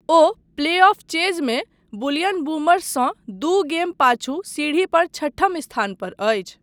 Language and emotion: Maithili, neutral